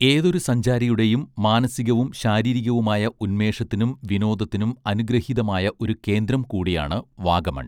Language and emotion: Malayalam, neutral